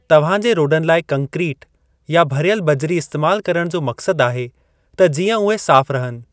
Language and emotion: Sindhi, neutral